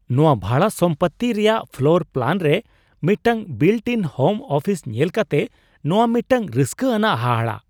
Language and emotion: Santali, surprised